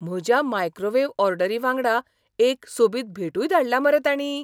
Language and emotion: Goan Konkani, surprised